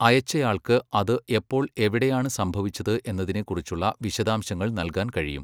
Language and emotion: Malayalam, neutral